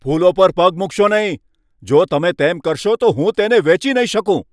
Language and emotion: Gujarati, angry